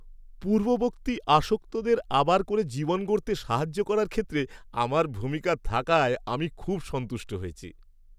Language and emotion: Bengali, happy